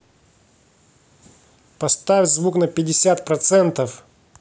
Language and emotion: Russian, angry